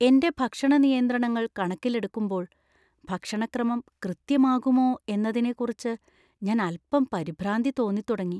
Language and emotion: Malayalam, fearful